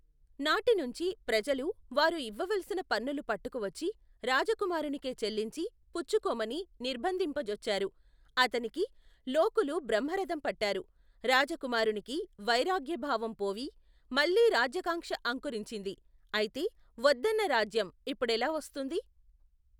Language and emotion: Telugu, neutral